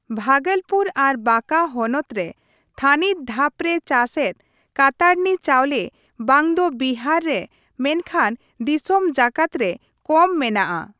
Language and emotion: Santali, neutral